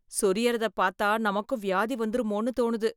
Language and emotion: Tamil, fearful